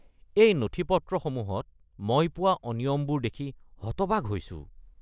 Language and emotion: Assamese, disgusted